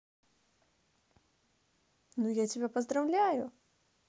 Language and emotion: Russian, positive